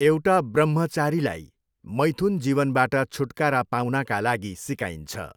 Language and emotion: Nepali, neutral